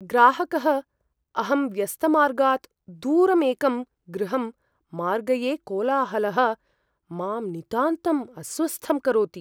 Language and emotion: Sanskrit, fearful